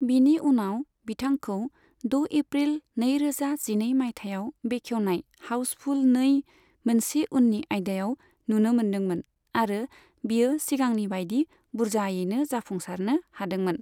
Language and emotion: Bodo, neutral